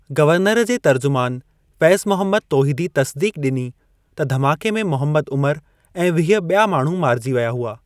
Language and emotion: Sindhi, neutral